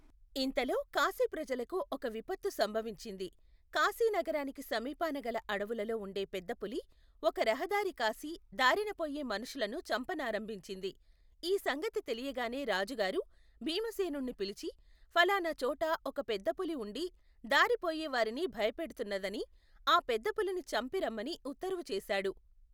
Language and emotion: Telugu, neutral